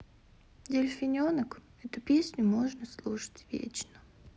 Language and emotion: Russian, sad